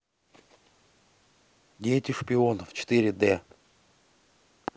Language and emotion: Russian, neutral